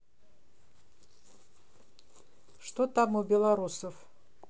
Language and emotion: Russian, neutral